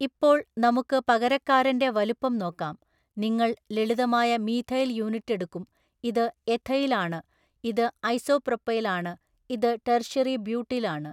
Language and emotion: Malayalam, neutral